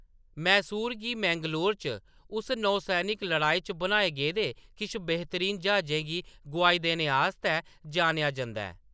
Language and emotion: Dogri, neutral